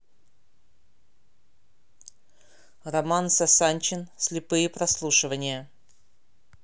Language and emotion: Russian, neutral